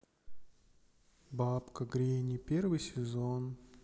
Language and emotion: Russian, sad